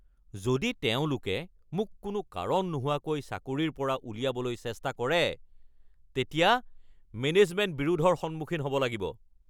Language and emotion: Assamese, angry